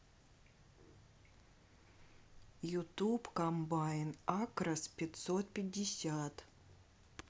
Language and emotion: Russian, neutral